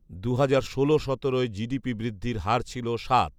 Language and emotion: Bengali, neutral